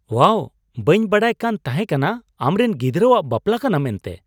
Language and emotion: Santali, surprised